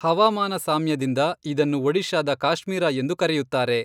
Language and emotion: Kannada, neutral